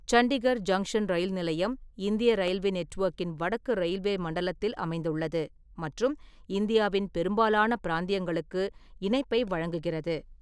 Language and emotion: Tamil, neutral